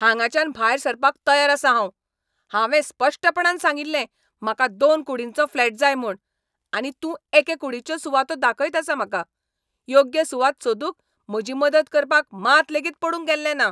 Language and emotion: Goan Konkani, angry